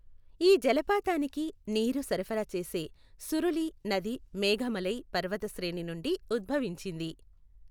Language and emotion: Telugu, neutral